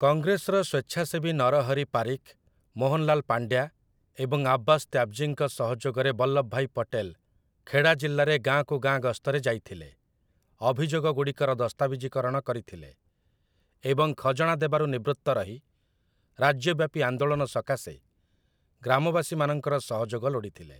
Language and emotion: Odia, neutral